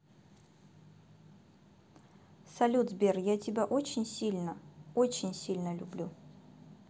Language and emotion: Russian, positive